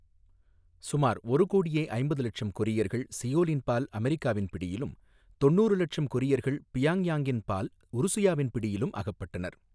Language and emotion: Tamil, neutral